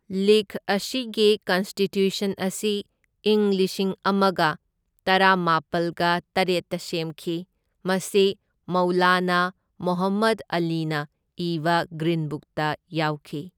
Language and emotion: Manipuri, neutral